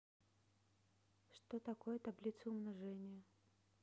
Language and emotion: Russian, neutral